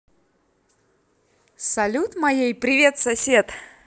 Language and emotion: Russian, positive